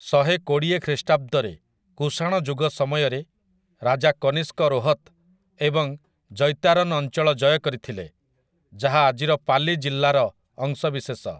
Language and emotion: Odia, neutral